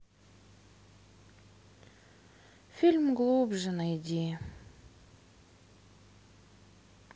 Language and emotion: Russian, sad